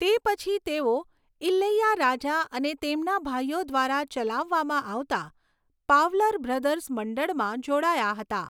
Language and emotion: Gujarati, neutral